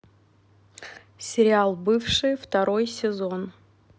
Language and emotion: Russian, neutral